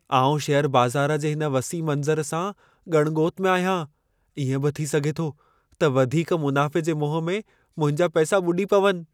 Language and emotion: Sindhi, fearful